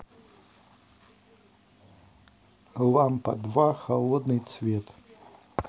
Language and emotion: Russian, neutral